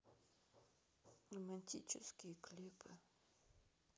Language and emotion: Russian, sad